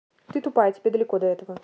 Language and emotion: Russian, angry